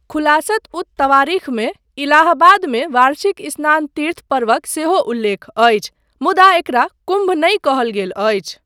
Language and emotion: Maithili, neutral